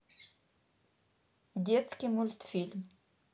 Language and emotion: Russian, neutral